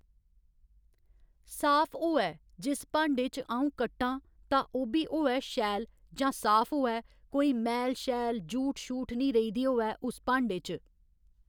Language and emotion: Dogri, neutral